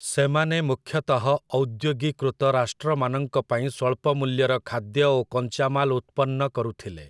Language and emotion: Odia, neutral